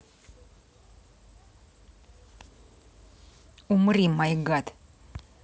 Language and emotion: Russian, angry